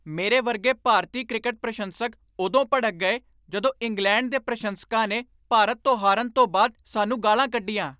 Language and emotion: Punjabi, angry